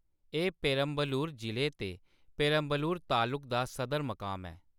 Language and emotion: Dogri, neutral